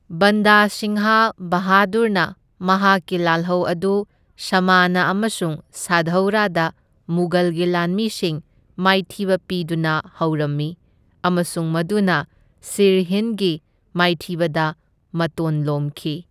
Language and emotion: Manipuri, neutral